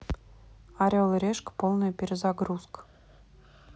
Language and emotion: Russian, neutral